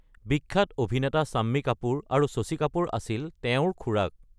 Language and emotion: Assamese, neutral